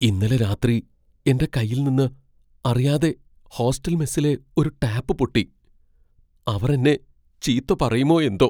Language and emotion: Malayalam, fearful